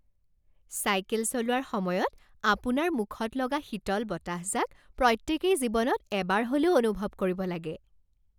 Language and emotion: Assamese, happy